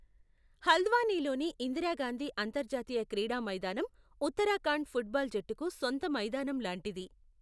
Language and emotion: Telugu, neutral